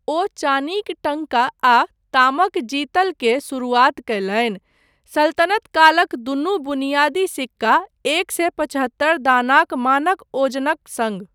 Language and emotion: Maithili, neutral